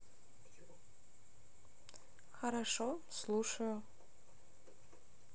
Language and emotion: Russian, neutral